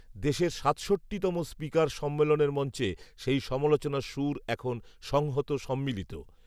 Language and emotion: Bengali, neutral